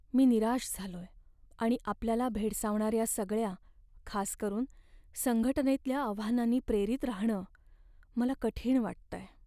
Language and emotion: Marathi, sad